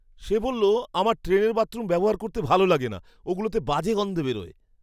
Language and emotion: Bengali, disgusted